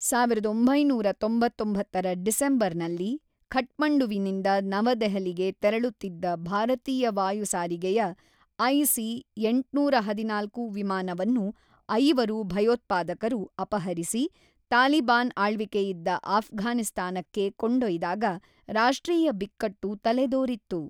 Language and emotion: Kannada, neutral